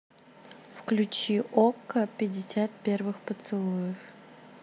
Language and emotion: Russian, neutral